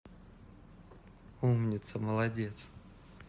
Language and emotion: Russian, neutral